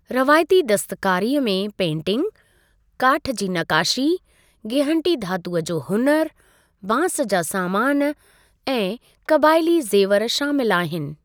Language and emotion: Sindhi, neutral